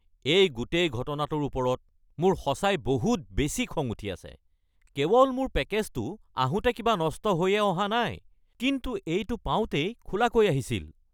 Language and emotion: Assamese, angry